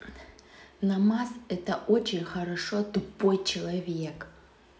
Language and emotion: Russian, angry